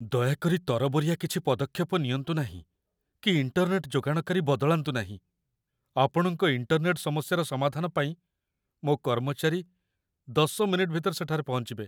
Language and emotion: Odia, fearful